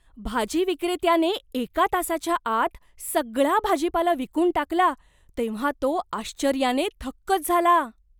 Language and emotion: Marathi, surprised